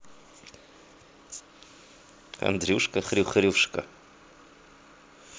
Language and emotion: Russian, positive